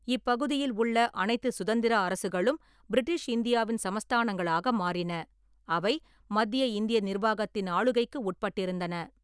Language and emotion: Tamil, neutral